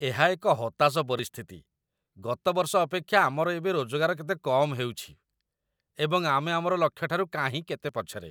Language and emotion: Odia, disgusted